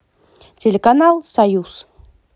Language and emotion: Russian, positive